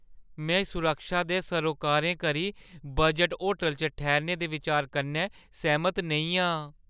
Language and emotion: Dogri, fearful